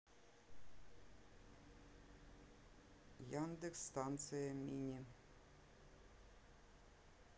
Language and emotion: Russian, neutral